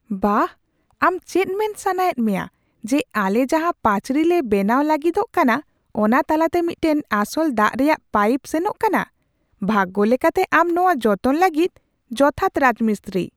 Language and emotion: Santali, surprised